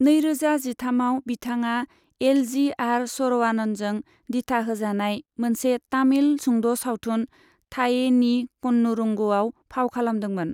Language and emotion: Bodo, neutral